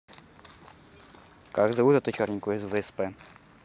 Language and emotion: Russian, neutral